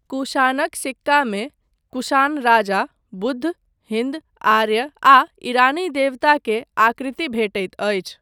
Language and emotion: Maithili, neutral